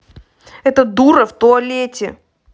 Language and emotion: Russian, angry